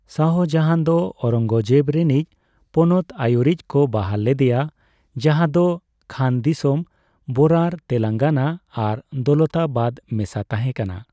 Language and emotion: Santali, neutral